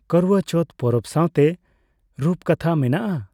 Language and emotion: Santali, neutral